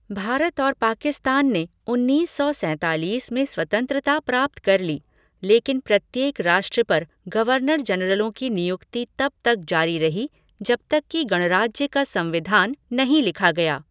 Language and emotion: Hindi, neutral